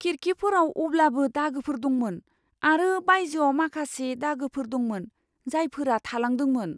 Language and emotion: Bodo, fearful